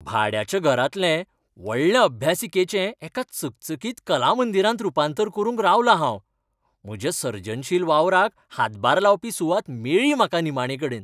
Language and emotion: Goan Konkani, happy